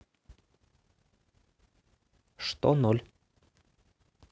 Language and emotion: Russian, neutral